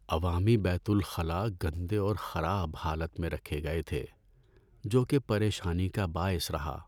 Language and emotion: Urdu, sad